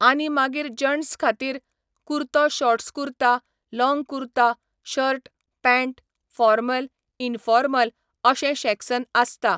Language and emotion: Goan Konkani, neutral